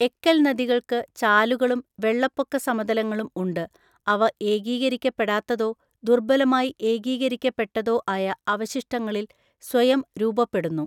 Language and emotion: Malayalam, neutral